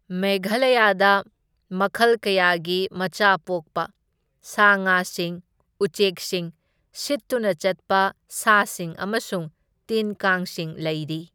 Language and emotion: Manipuri, neutral